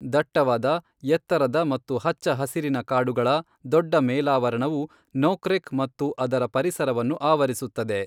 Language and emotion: Kannada, neutral